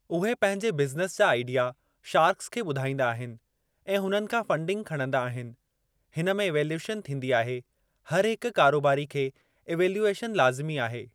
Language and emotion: Sindhi, neutral